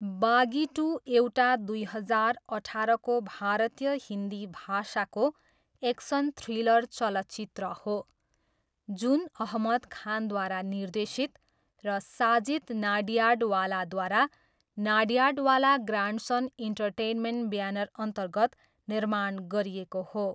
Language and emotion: Nepali, neutral